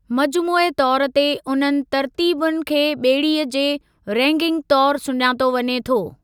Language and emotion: Sindhi, neutral